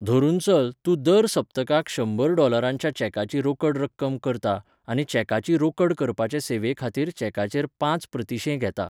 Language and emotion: Goan Konkani, neutral